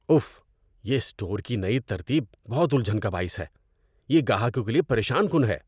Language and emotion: Urdu, disgusted